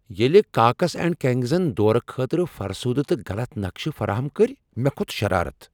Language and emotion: Kashmiri, angry